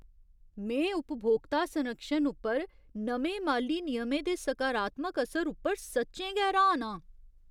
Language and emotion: Dogri, surprised